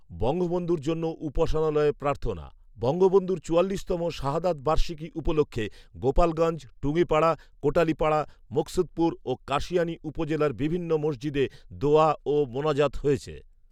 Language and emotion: Bengali, neutral